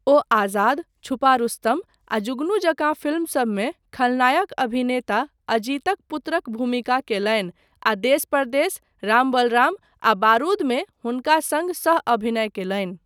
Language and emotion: Maithili, neutral